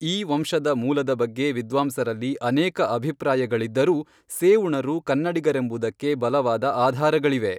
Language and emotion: Kannada, neutral